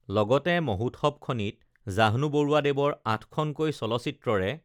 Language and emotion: Assamese, neutral